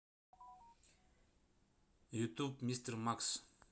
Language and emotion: Russian, neutral